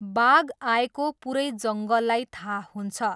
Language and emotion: Nepali, neutral